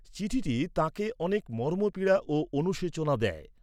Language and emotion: Bengali, neutral